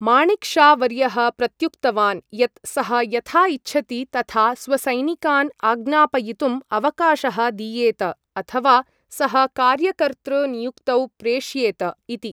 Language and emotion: Sanskrit, neutral